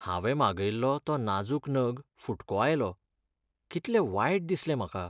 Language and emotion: Goan Konkani, sad